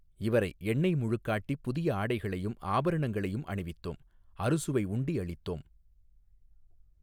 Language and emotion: Tamil, neutral